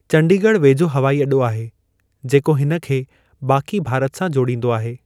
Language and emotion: Sindhi, neutral